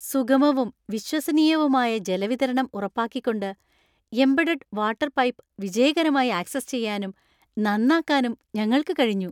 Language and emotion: Malayalam, happy